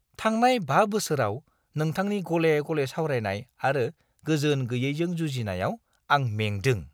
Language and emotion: Bodo, disgusted